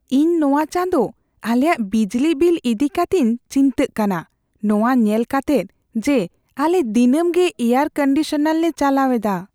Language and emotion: Santali, fearful